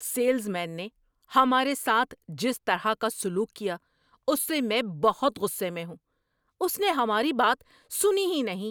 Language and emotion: Urdu, angry